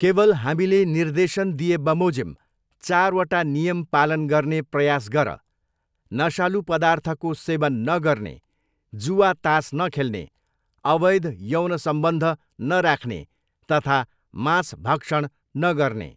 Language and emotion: Nepali, neutral